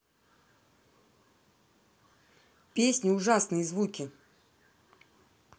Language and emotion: Russian, angry